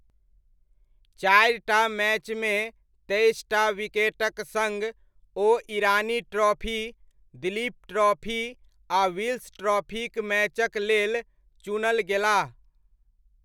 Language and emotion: Maithili, neutral